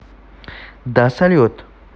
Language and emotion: Russian, neutral